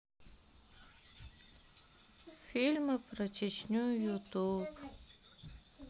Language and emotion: Russian, sad